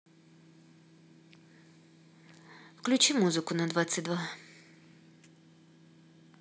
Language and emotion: Russian, neutral